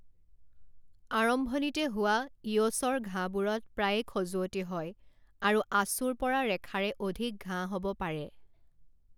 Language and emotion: Assamese, neutral